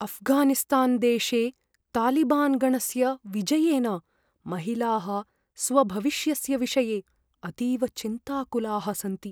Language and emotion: Sanskrit, fearful